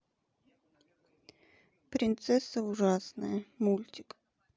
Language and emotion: Russian, neutral